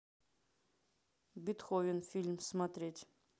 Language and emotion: Russian, neutral